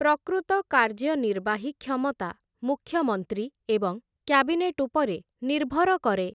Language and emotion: Odia, neutral